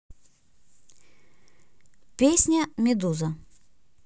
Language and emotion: Russian, neutral